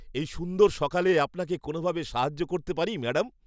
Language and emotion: Bengali, happy